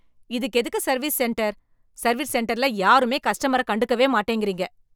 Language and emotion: Tamil, angry